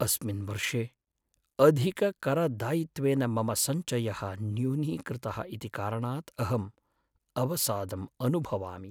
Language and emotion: Sanskrit, sad